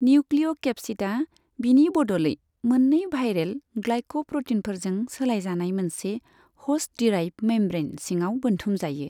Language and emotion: Bodo, neutral